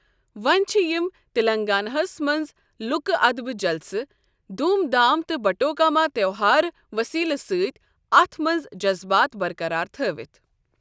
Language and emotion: Kashmiri, neutral